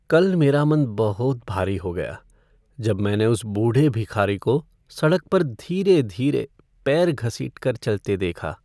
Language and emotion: Hindi, sad